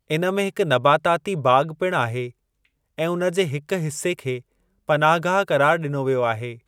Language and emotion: Sindhi, neutral